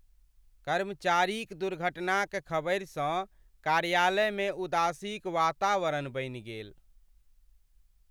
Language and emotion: Maithili, sad